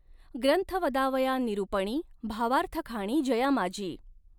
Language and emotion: Marathi, neutral